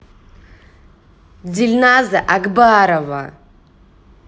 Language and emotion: Russian, angry